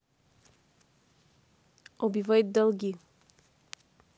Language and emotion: Russian, neutral